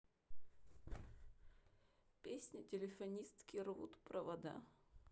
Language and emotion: Russian, sad